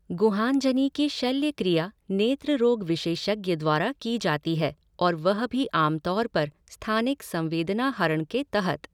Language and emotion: Hindi, neutral